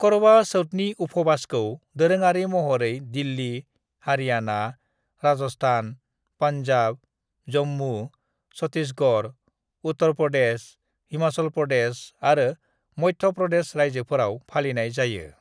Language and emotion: Bodo, neutral